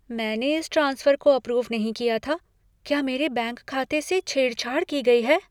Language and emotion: Hindi, fearful